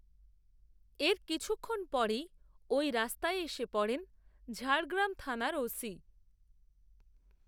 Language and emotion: Bengali, neutral